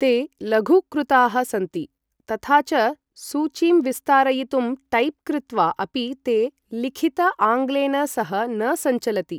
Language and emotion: Sanskrit, neutral